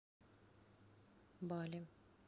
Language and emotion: Russian, neutral